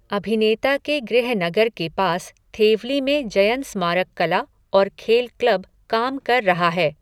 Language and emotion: Hindi, neutral